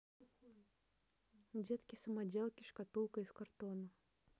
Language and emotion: Russian, neutral